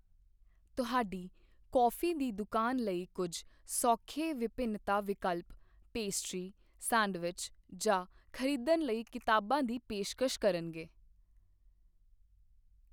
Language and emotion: Punjabi, neutral